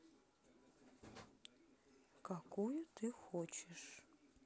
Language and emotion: Russian, sad